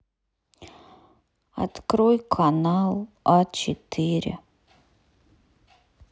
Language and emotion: Russian, sad